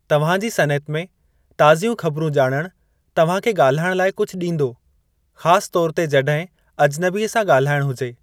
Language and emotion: Sindhi, neutral